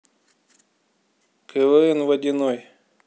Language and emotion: Russian, neutral